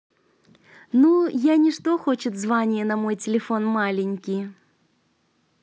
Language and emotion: Russian, positive